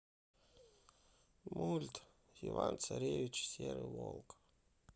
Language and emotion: Russian, sad